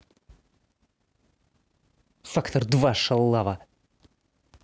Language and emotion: Russian, angry